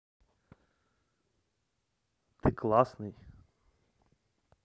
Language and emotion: Russian, neutral